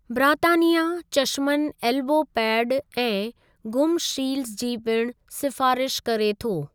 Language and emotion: Sindhi, neutral